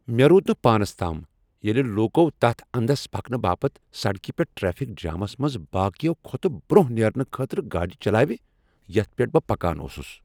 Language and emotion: Kashmiri, angry